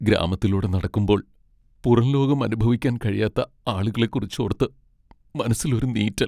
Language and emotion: Malayalam, sad